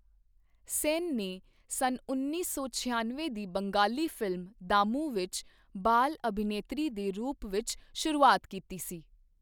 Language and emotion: Punjabi, neutral